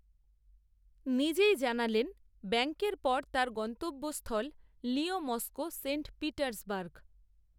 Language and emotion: Bengali, neutral